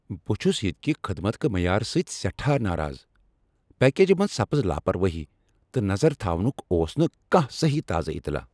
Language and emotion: Kashmiri, angry